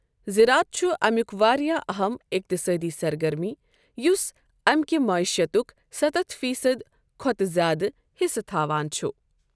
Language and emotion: Kashmiri, neutral